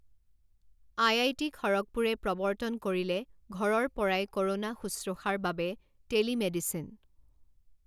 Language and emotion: Assamese, neutral